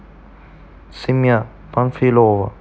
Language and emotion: Russian, neutral